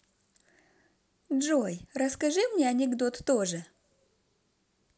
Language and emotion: Russian, positive